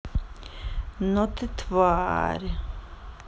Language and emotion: Russian, angry